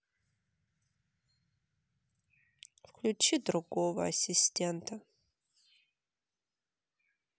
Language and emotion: Russian, sad